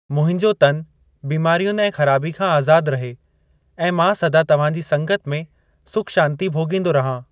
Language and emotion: Sindhi, neutral